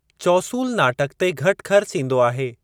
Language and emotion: Sindhi, neutral